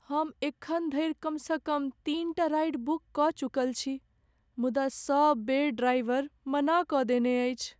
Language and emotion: Maithili, sad